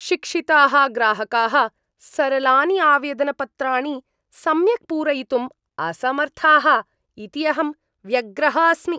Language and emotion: Sanskrit, disgusted